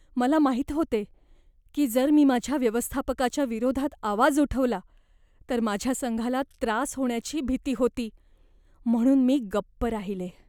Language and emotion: Marathi, fearful